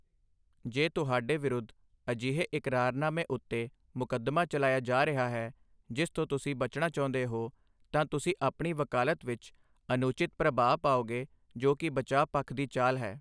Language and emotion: Punjabi, neutral